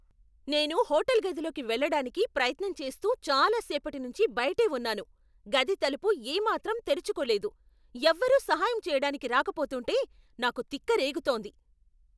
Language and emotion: Telugu, angry